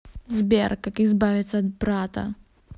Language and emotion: Russian, angry